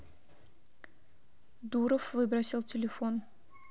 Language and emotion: Russian, neutral